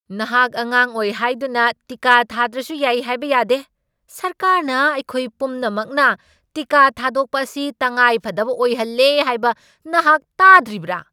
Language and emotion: Manipuri, angry